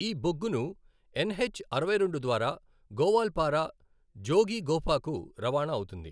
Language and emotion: Telugu, neutral